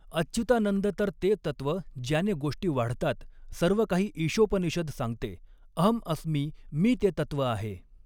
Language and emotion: Marathi, neutral